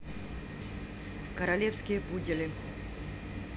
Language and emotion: Russian, neutral